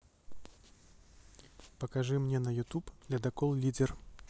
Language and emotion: Russian, neutral